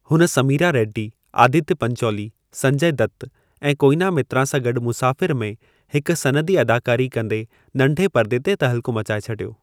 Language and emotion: Sindhi, neutral